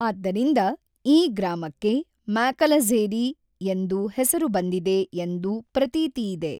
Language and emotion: Kannada, neutral